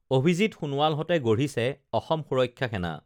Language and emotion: Assamese, neutral